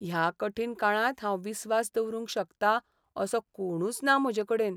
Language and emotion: Goan Konkani, sad